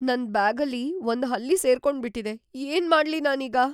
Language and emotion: Kannada, fearful